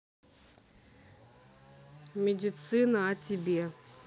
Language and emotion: Russian, neutral